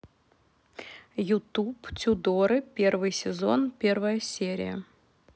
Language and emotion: Russian, neutral